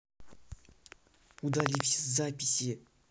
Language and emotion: Russian, angry